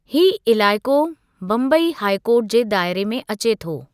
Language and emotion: Sindhi, neutral